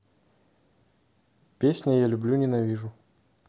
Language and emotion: Russian, neutral